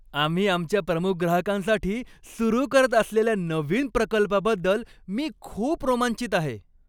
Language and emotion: Marathi, happy